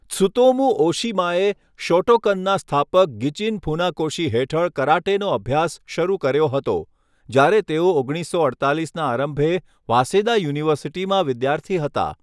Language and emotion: Gujarati, neutral